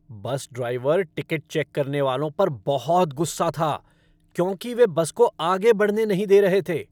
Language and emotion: Hindi, angry